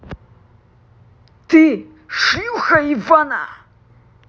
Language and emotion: Russian, angry